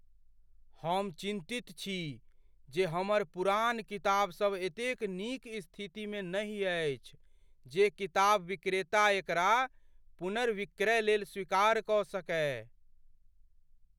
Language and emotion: Maithili, fearful